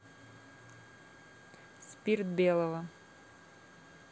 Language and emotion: Russian, neutral